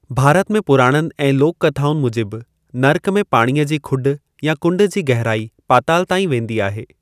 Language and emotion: Sindhi, neutral